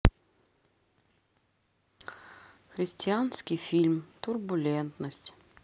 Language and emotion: Russian, sad